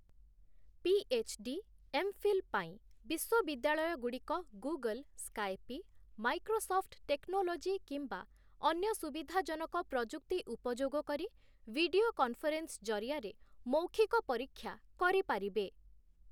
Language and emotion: Odia, neutral